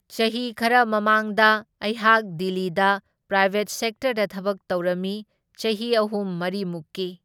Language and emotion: Manipuri, neutral